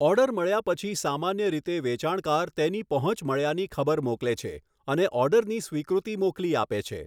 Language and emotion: Gujarati, neutral